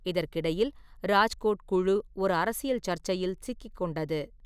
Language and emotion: Tamil, neutral